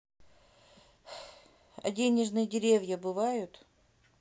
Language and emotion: Russian, sad